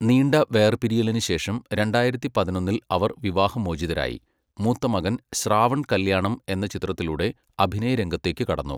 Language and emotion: Malayalam, neutral